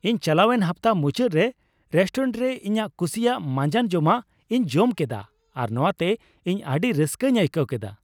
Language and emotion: Santali, happy